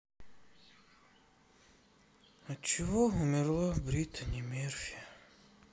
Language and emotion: Russian, sad